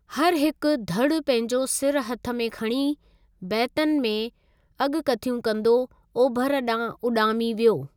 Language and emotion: Sindhi, neutral